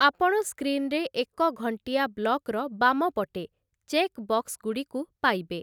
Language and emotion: Odia, neutral